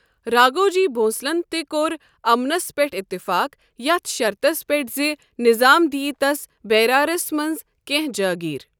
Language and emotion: Kashmiri, neutral